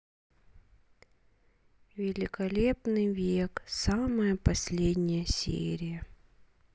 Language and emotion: Russian, sad